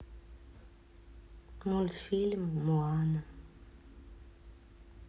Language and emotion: Russian, sad